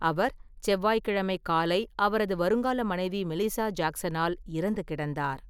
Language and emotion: Tamil, neutral